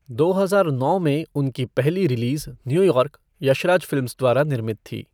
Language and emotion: Hindi, neutral